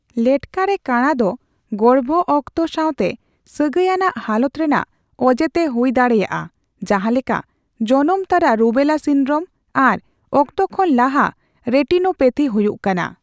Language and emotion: Santali, neutral